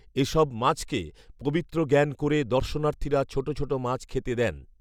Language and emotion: Bengali, neutral